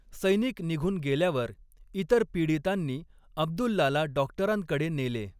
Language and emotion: Marathi, neutral